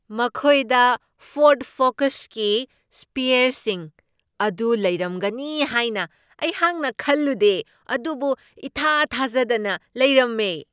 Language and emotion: Manipuri, surprised